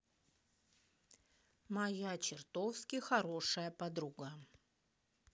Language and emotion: Russian, neutral